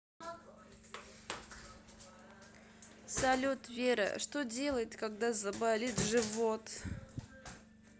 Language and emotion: Russian, sad